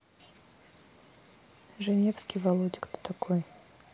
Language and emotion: Russian, neutral